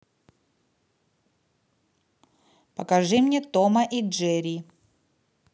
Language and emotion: Russian, neutral